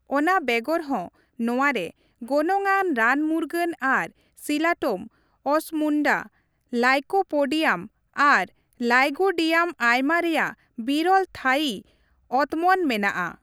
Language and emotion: Santali, neutral